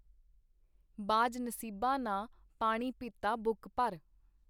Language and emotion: Punjabi, neutral